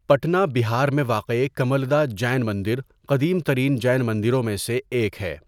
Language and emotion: Urdu, neutral